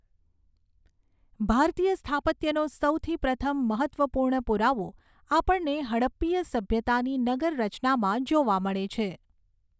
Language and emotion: Gujarati, neutral